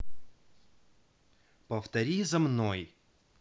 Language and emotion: Russian, neutral